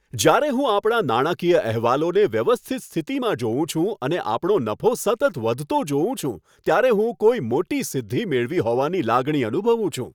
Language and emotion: Gujarati, happy